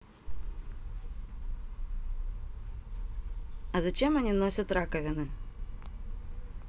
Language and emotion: Russian, neutral